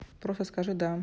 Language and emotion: Russian, neutral